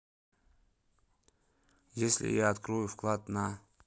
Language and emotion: Russian, neutral